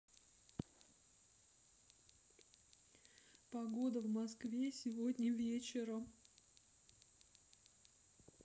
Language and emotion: Russian, sad